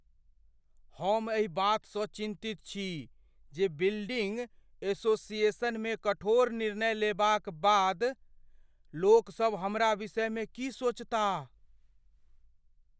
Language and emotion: Maithili, fearful